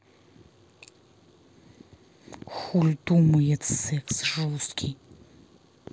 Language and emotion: Russian, angry